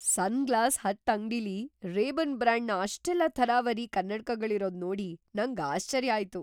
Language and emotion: Kannada, surprised